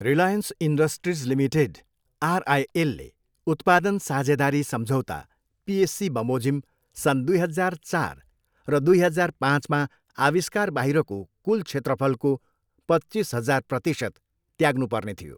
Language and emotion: Nepali, neutral